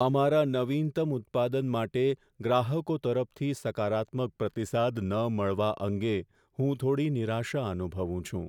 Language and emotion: Gujarati, sad